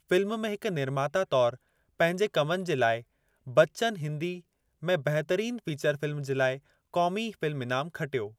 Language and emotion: Sindhi, neutral